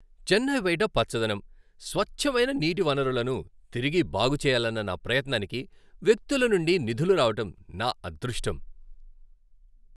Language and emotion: Telugu, happy